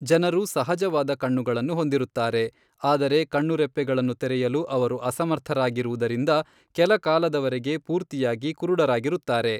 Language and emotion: Kannada, neutral